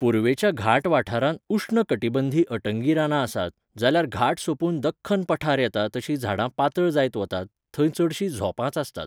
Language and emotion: Goan Konkani, neutral